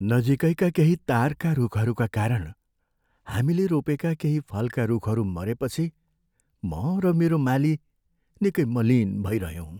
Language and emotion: Nepali, sad